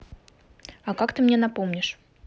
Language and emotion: Russian, neutral